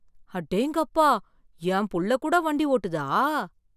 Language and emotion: Tamil, surprised